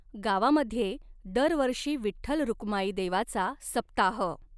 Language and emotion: Marathi, neutral